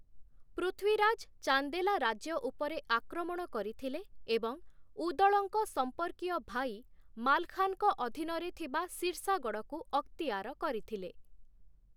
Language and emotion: Odia, neutral